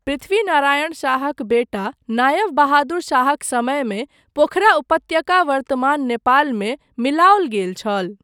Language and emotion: Maithili, neutral